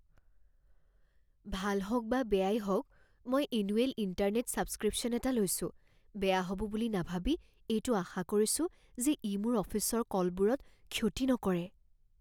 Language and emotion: Assamese, fearful